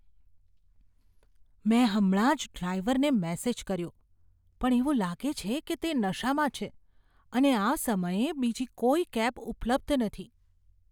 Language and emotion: Gujarati, fearful